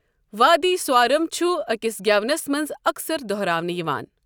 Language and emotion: Kashmiri, neutral